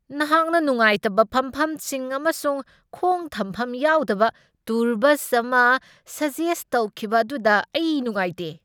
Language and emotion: Manipuri, angry